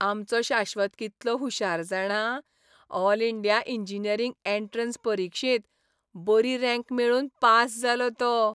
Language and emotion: Goan Konkani, happy